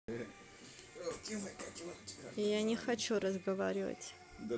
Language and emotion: Russian, neutral